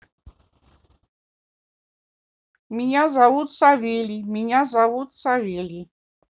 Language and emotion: Russian, neutral